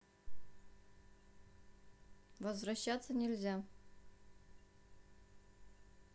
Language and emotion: Russian, neutral